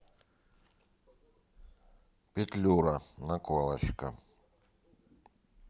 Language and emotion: Russian, neutral